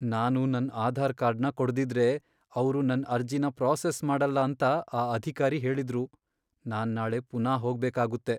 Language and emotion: Kannada, sad